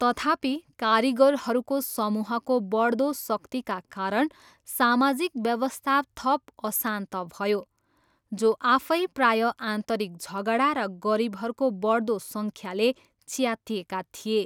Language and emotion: Nepali, neutral